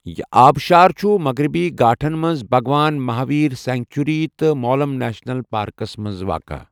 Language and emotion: Kashmiri, neutral